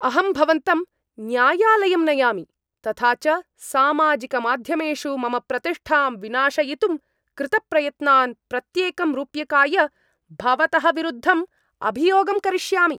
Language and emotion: Sanskrit, angry